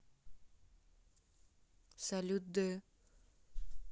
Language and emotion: Russian, neutral